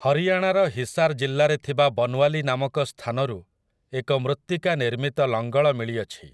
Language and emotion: Odia, neutral